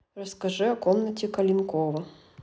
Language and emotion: Russian, neutral